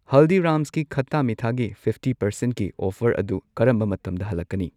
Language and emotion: Manipuri, neutral